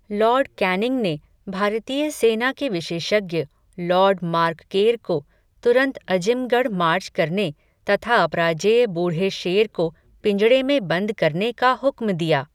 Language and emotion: Hindi, neutral